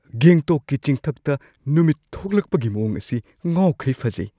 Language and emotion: Manipuri, surprised